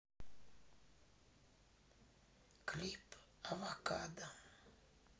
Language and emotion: Russian, sad